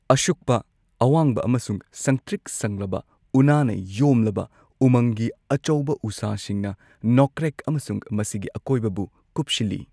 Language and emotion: Manipuri, neutral